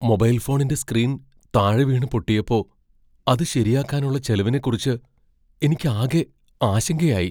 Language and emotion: Malayalam, fearful